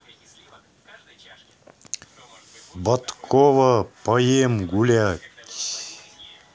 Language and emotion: Russian, neutral